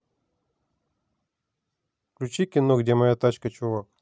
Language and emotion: Russian, neutral